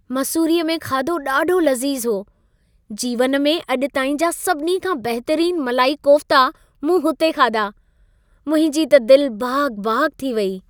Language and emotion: Sindhi, happy